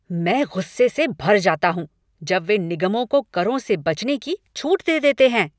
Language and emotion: Hindi, angry